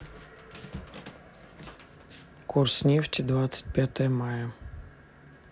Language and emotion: Russian, neutral